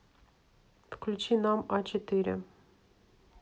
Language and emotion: Russian, neutral